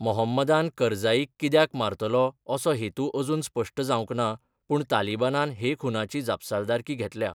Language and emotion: Goan Konkani, neutral